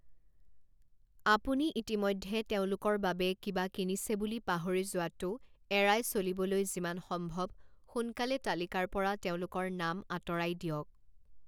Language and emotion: Assamese, neutral